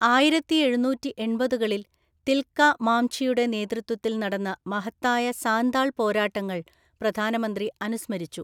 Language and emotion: Malayalam, neutral